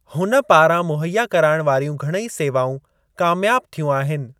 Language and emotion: Sindhi, neutral